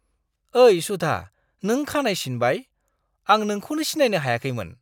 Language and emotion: Bodo, surprised